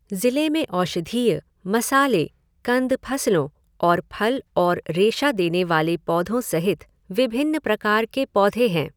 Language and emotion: Hindi, neutral